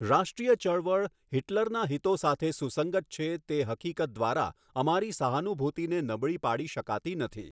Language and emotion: Gujarati, neutral